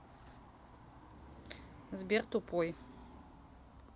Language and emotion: Russian, neutral